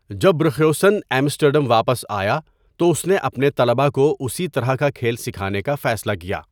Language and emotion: Urdu, neutral